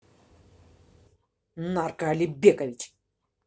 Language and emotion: Russian, angry